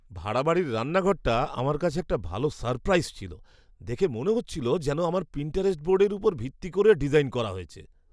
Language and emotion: Bengali, surprised